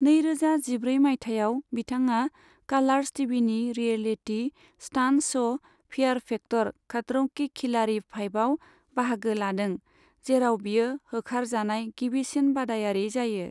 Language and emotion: Bodo, neutral